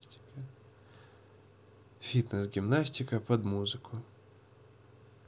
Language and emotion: Russian, neutral